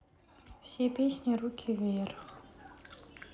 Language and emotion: Russian, sad